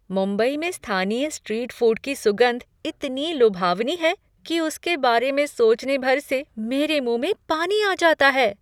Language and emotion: Hindi, surprised